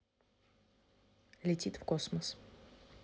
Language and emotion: Russian, neutral